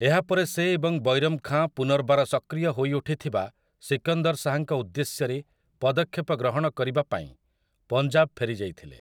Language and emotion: Odia, neutral